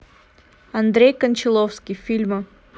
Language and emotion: Russian, neutral